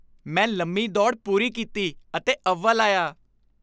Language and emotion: Punjabi, happy